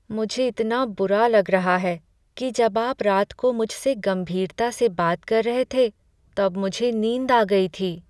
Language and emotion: Hindi, sad